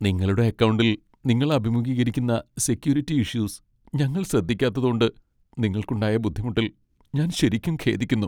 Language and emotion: Malayalam, sad